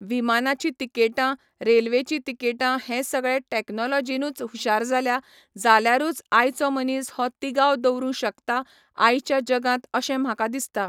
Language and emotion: Goan Konkani, neutral